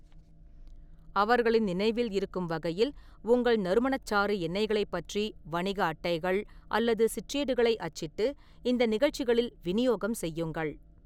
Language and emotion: Tamil, neutral